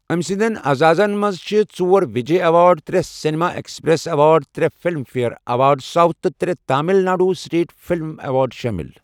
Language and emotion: Kashmiri, neutral